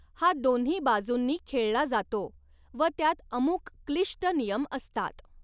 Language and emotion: Marathi, neutral